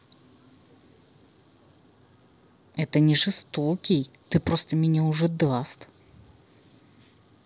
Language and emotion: Russian, angry